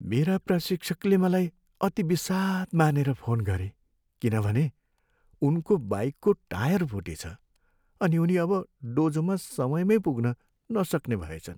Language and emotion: Nepali, sad